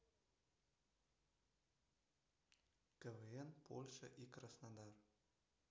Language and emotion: Russian, neutral